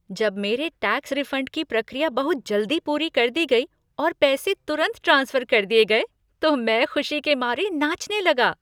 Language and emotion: Hindi, happy